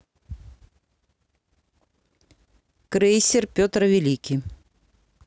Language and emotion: Russian, neutral